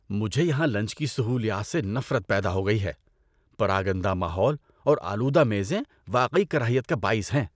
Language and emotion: Urdu, disgusted